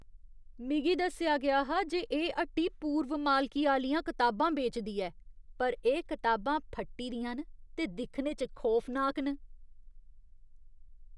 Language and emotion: Dogri, disgusted